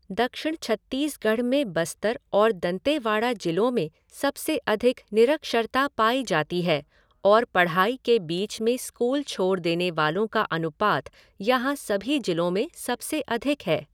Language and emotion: Hindi, neutral